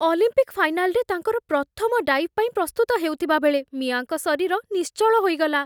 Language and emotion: Odia, fearful